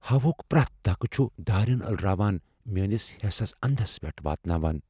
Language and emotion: Kashmiri, fearful